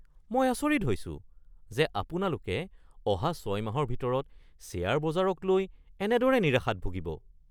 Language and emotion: Assamese, surprised